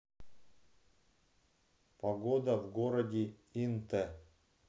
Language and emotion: Russian, neutral